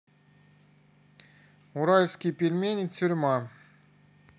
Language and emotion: Russian, neutral